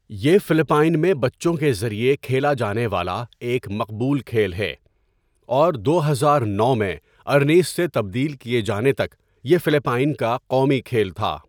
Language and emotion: Urdu, neutral